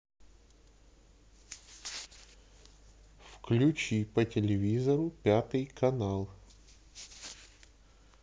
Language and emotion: Russian, neutral